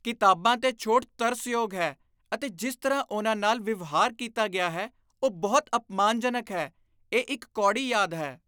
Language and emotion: Punjabi, disgusted